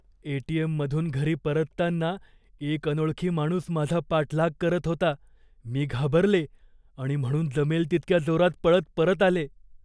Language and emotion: Marathi, fearful